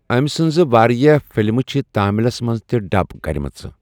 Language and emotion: Kashmiri, neutral